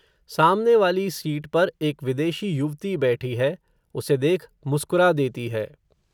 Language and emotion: Hindi, neutral